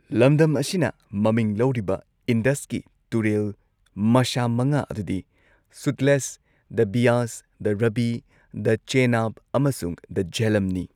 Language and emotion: Manipuri, neutral